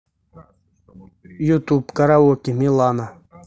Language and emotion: Russian, neutral